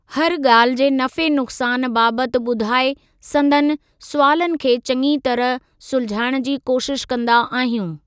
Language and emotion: Sindhi, neutral